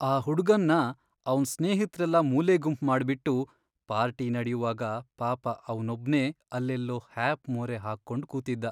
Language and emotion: Kannada, sad